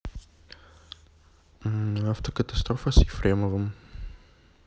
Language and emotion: Russian, neutral